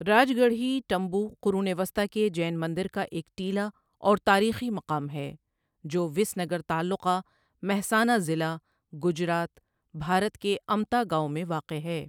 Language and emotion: Urdu, neutral